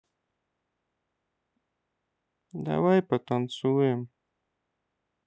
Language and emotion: Russian, sad